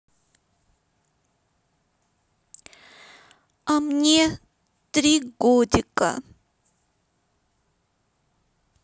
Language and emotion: Russian, sad